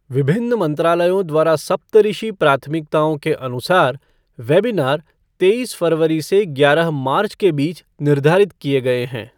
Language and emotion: Hindi, neutral